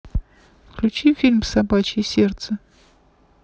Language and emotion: Russian, neutral